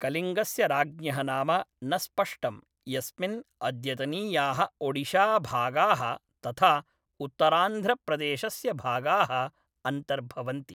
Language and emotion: Sanskrit, neutral